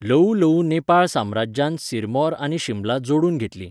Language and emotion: Goan Konkani, neutral